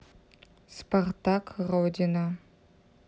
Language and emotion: Russian, neutral